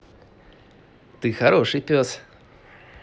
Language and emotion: Russian, positive